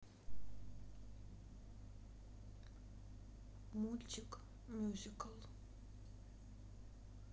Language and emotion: Russian, sad